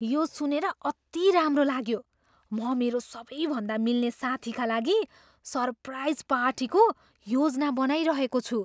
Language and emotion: Nepali, surprised